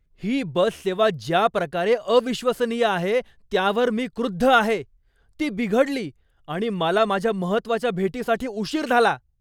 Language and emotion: Marathi, angry